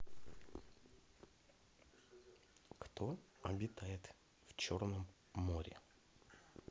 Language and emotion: Russian, neutral